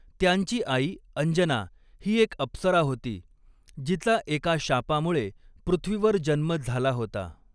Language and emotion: Marathi, neutral